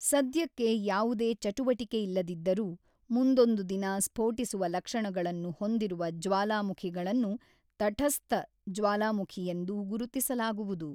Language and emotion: Kannada, neutral